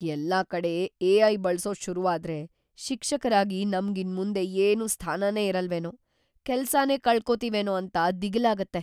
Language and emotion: Kannada, fearful